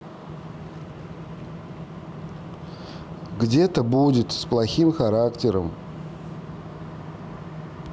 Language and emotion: Russian, neutral